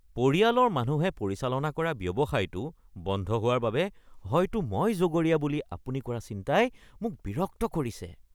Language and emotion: Assamese, disgusted